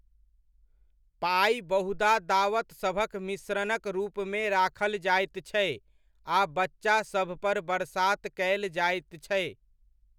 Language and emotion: Maithili, neutral